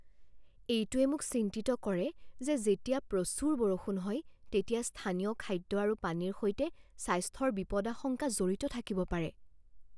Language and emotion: Assamese, fearful